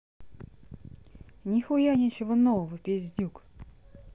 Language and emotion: Russian, neutral